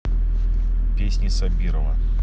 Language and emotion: Russian, neutral